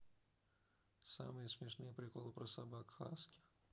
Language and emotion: Russian, neutral